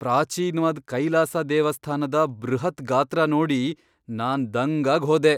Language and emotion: Kannada, surprised